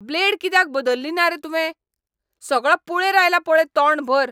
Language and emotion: Goan Konkani, angry